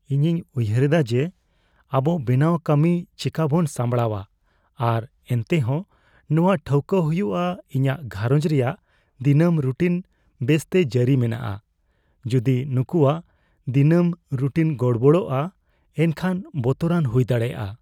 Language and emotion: Santali, fearful